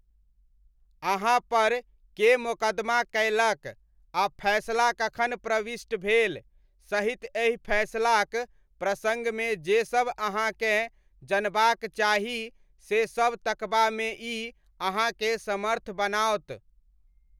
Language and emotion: Maithili, neutral